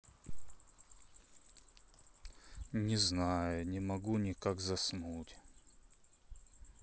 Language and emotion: Russian, sad